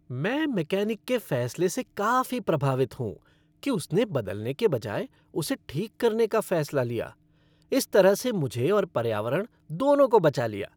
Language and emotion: Hindi, happy